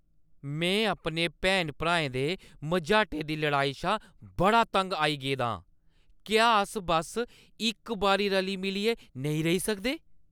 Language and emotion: Dogri, angry